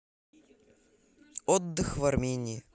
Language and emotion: Russian, neutral